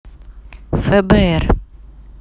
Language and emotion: Russian, neutral